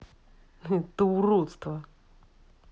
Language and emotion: Russian, angry